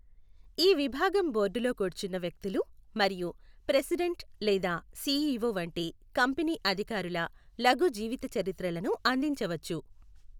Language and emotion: Telugu, neutral